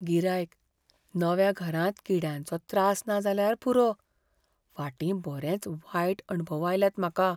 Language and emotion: Goan Konkani, fearful